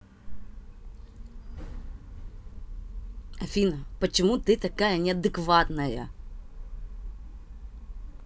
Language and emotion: Russian, angry